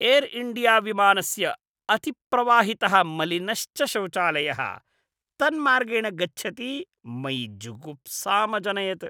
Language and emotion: Sanskrit, disgusted